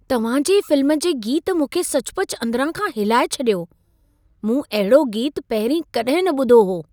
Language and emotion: Sindhi, surprised